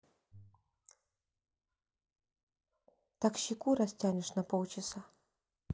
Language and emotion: Russian, neutral